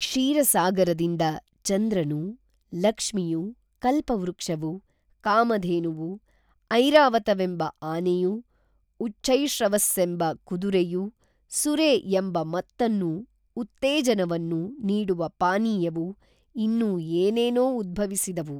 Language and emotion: Kannada, neutral